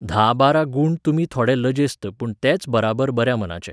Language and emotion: Goan Konkani, neutral